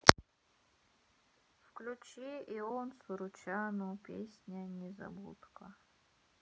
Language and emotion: Russian, sad